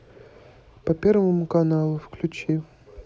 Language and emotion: Russian, neutral